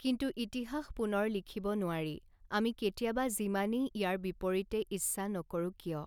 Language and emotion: Assamese, neutral